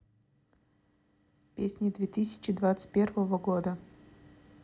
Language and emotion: Russian, neutral